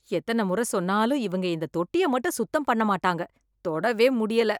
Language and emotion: Tamil, disgusted